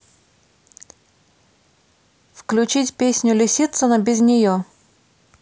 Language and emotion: Russian, neutral